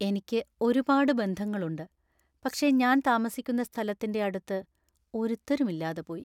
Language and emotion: Malayalam, sad